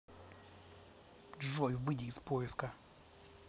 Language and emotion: Russian, angry